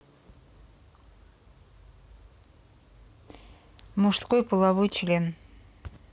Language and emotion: Russian, neutral